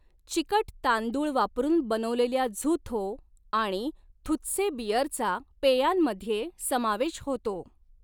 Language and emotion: Marathi, neutral